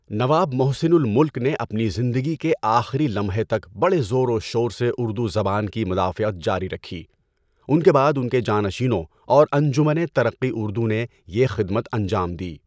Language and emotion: Urdu, neutral